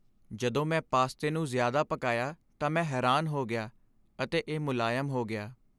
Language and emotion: Punjabi, sad